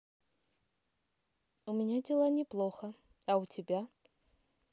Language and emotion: Russian, positive